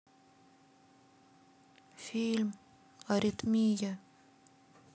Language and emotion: Russian, sad